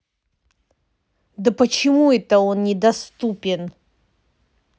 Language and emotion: Russian, angry